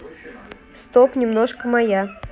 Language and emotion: Russian, neutral